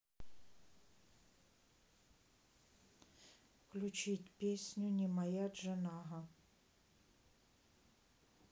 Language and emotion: Russian, neutral